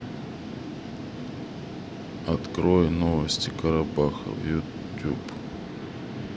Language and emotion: Russian, neutral